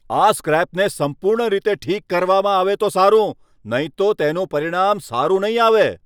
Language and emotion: Gujarati, angry